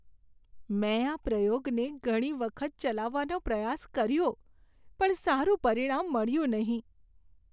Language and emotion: Gujarati, sad